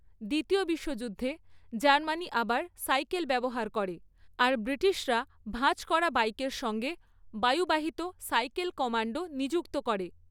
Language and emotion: Bengali, neutral